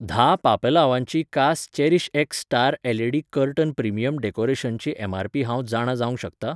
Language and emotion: Goan Konkani, neutral